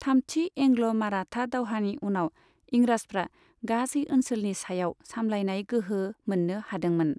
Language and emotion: Bodo, neutral